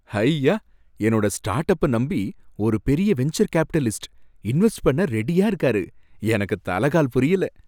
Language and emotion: Tamil, happy